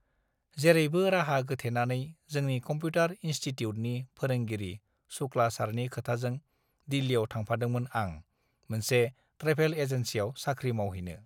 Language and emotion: Bodo, neutral